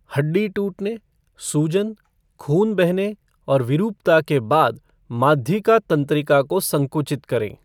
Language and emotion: Hindi, neutral